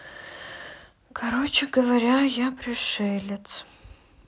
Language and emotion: Russian, sad